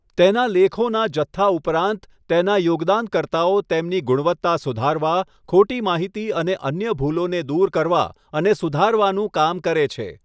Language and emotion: Gujarati, neutral